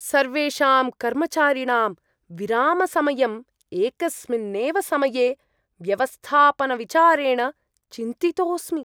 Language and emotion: Sanskrit, disgusted